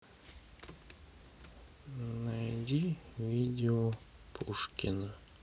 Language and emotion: Russian, sad